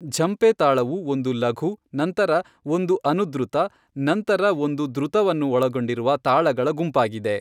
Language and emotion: Kannada, neutral